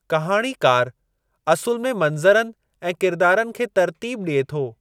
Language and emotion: Sindhi, neutral